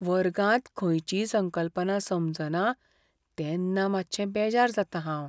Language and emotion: Goan Konkani, fearful